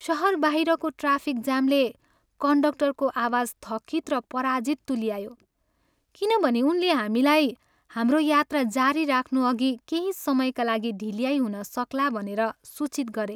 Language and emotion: Nepali, sad